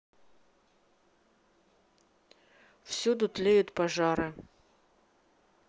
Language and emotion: Russian, sad